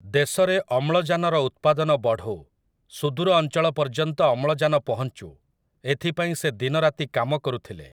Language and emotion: Odia, neutral